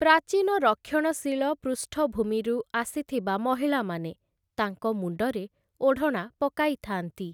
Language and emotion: Odia, neutral